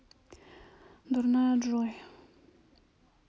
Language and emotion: Russian, sad